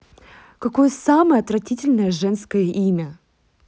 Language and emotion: Russian, angry